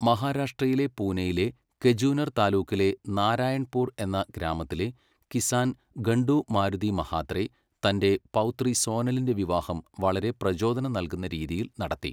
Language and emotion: Malayalam, neutral